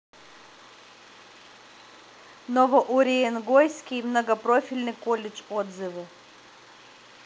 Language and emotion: Russian, neutral